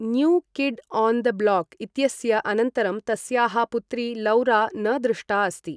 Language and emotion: Sanskrit, neutral